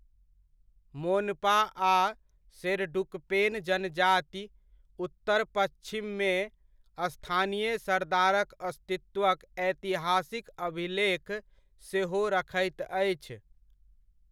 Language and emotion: Maithili, neutral